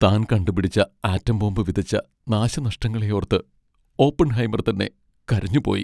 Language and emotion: Malayalam, sad